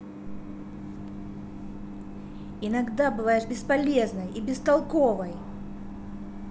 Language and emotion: Russian, angry